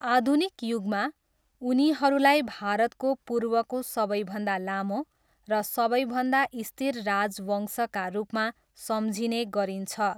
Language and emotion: Nepali, neutral